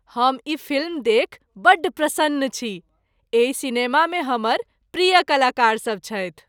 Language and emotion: Maithili, happy